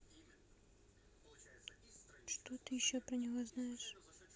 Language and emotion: Russian, neutral